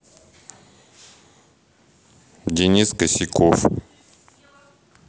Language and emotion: Russian, neutral